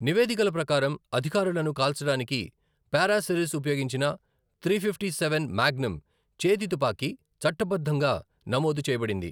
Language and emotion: Telugu, neutral